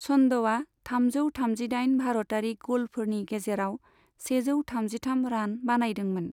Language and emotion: Bodo, neutral